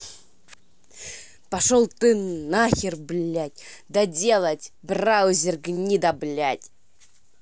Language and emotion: Russian, angry